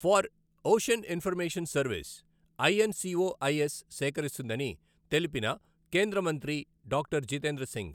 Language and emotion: Telugu, neutral